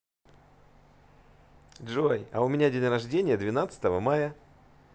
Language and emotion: Russian, positive